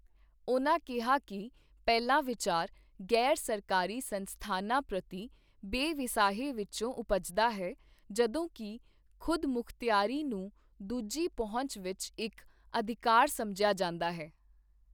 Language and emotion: Punjabi, neutral